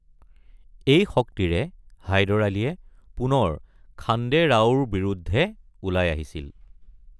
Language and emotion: Assamese, neutral